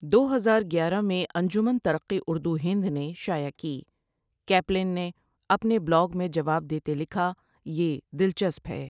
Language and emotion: Urdu, neutral